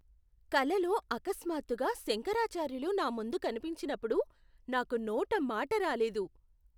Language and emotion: Telugu, surprised